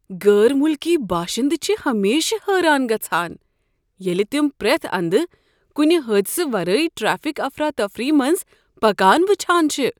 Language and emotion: Kashmiri, surprised